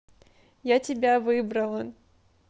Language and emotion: Russian, neutral